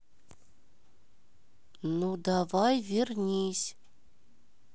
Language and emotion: Russian, neutral